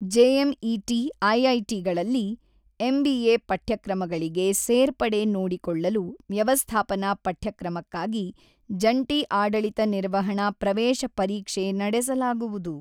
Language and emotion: Kannada, neutral